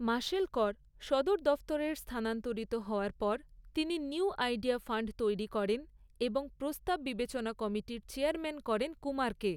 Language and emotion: Bengali, neutral